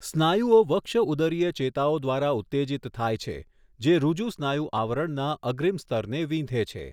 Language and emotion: Gujarati, neutral